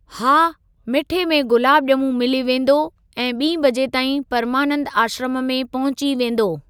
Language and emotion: Sindhi, neutral